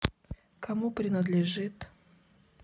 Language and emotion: Russian, neutral